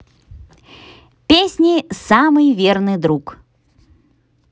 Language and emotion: Russian, positive